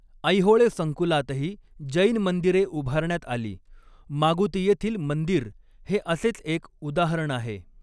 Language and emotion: Marathi, neutral